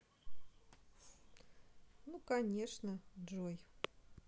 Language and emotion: Russian, neutral